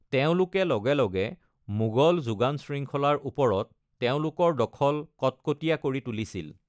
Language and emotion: Assamese, neutral